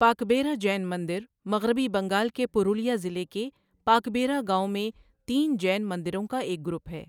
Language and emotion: Urdu, neutral